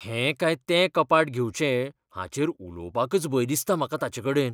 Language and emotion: Goan Konkani, fearful